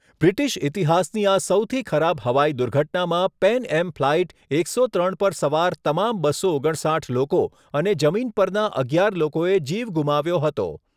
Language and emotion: Gujarati, neutral